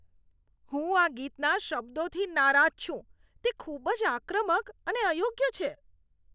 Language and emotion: Gujarati, disgusted